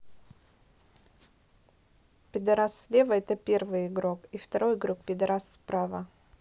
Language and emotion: Russian, neutral